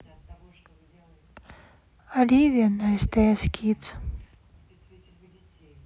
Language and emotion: Russian, neutral